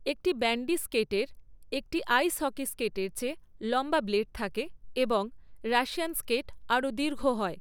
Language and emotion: Bengali, neutral